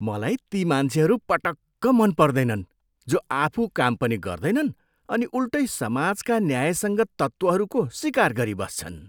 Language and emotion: Nepali, disgusted